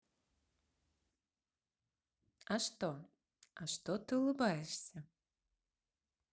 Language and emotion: Russian, positive